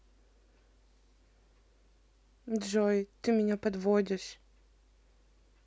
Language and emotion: Russian, sad